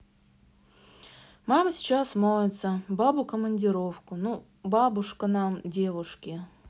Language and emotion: Russian, neutral